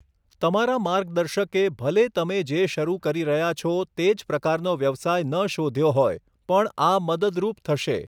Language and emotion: Gujarati, neutral